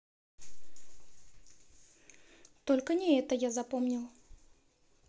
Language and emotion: Russian, neutral